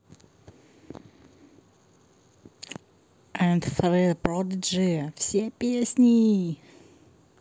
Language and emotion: Russian, positive